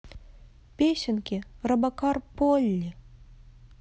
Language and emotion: Russian, sad